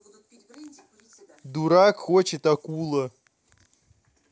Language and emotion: Russian, neutral